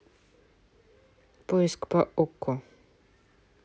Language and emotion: Russian, neutral